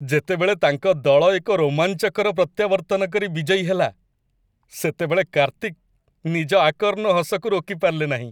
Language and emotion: Odia, happy